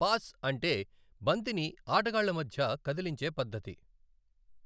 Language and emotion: Telugu, neutral